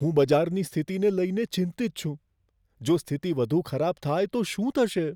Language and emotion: Gujarati, fearful